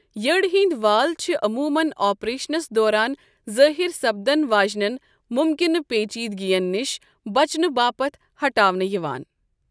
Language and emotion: Kashmiri, neutral